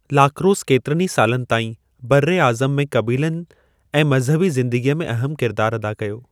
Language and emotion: Sindhi, neutral